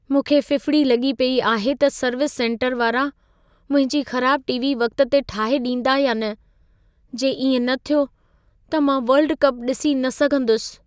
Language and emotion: Sindhi, fearful